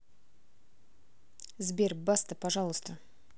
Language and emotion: Russian, neutral